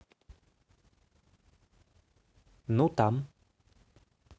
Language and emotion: Russian, neutral